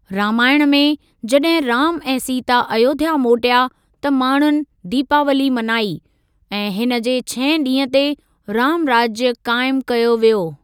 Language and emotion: Sindhi, neutral